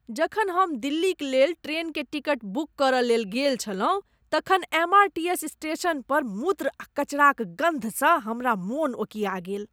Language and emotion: Maithili, disgusted